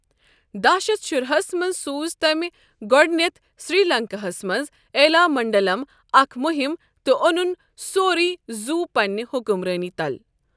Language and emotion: Kashmiri, neutral